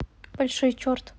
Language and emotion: Russian, neutral